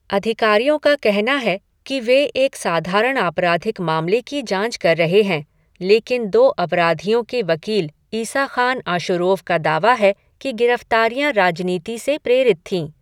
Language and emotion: Hindi, neutral